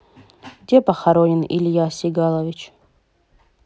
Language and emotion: Russian, neutral